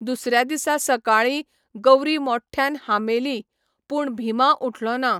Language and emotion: Goan Konkani, neutral